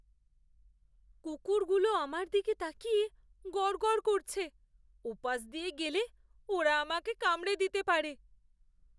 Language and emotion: Bengali, fearful